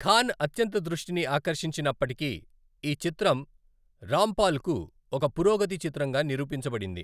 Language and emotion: Telugu, neutral